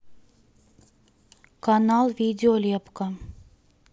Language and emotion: Russian, neutral